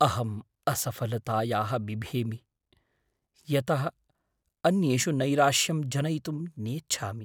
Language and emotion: Sanskrit, fearful